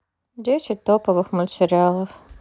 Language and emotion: Russian, neutral